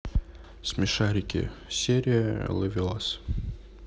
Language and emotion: Russian, neutral